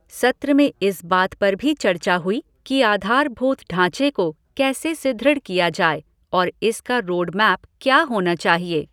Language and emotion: Hindi, neutral